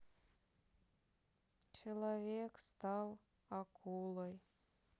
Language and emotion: Russian, sad